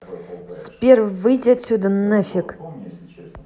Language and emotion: Russian, angry